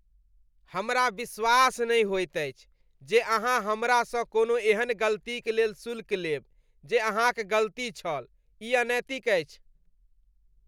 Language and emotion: Maithili, disgusted